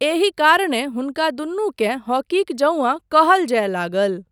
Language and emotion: Maithili, neutral